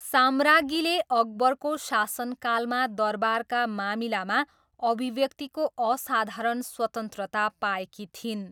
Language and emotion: Nepali, neutral